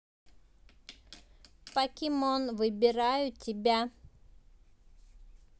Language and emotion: Russian, positive